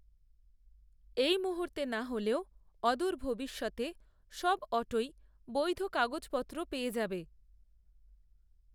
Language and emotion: Bengali, neutral